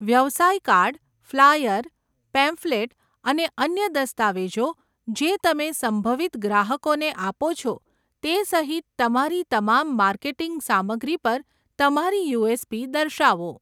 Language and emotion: Gujarati, neutral